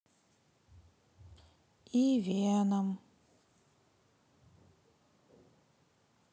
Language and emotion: Russian, sad